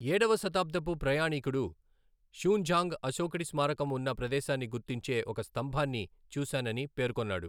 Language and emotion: Telugu, neutral